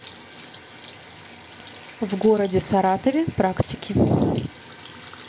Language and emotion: Russian, neutral